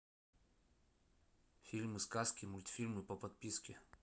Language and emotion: Russian, neutral